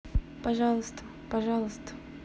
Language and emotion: Russian, neutral